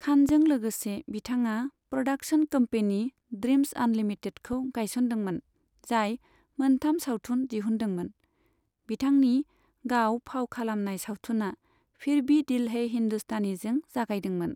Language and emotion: Bodo, neutral